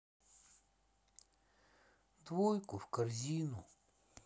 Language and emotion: Russian, sad